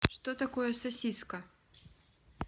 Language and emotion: Russian, neutral